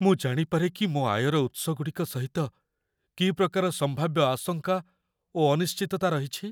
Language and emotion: Odia, fearful